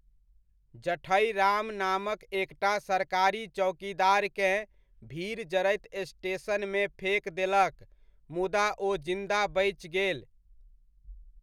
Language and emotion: Maithili, neutral